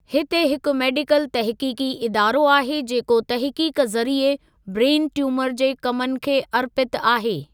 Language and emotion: Sindhi, neutral